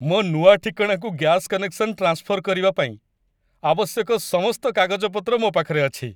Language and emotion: Odia, happy